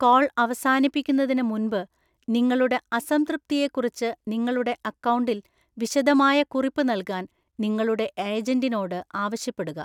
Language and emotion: Malayalam, neutral